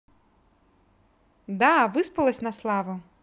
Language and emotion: Russian, positive